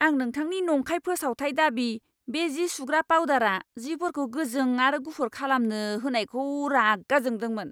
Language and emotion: Bodo, angry